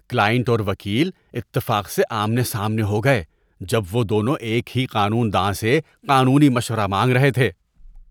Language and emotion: Urdu, disgusted